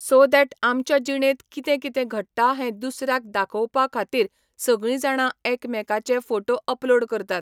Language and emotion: Goan Konkani, neutral